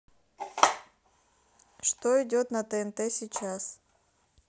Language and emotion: Russian, neutral